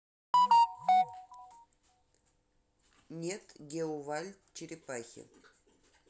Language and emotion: Russian, neutral